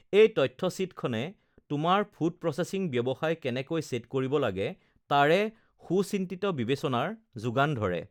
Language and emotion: Assamese, neutral